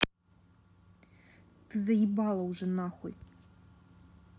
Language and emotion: Russian, angry